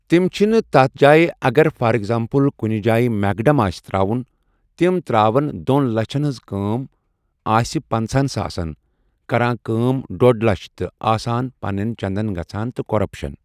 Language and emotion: Kashmiri, neutral